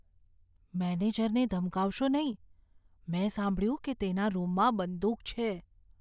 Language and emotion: Gujarati, fearful